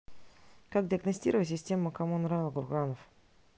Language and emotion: Russian, neutral